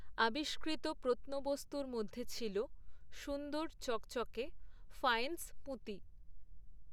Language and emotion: Bengali, neutral